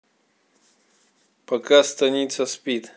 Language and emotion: Russian, neutral